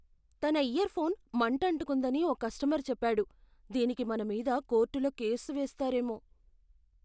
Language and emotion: Telugu, fearful